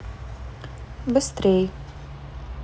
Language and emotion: Russian, neutral